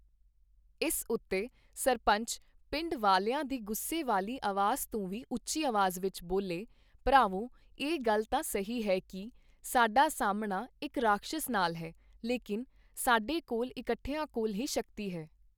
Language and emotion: Punjabi, neutral